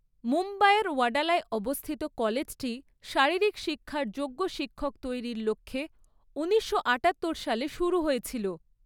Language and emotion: Bengali, neutral